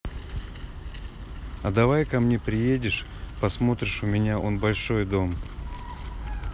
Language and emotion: Russian, neutral